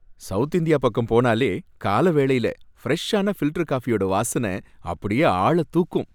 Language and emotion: Tamil, happy